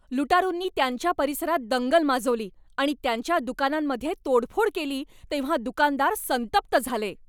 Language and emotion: Marathi, angry